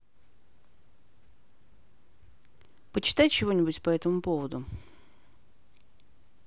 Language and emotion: Russian, neutral